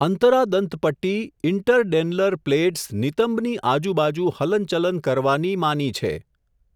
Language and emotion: Gujarati, neutral